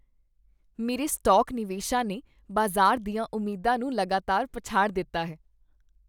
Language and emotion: Punjabi, happy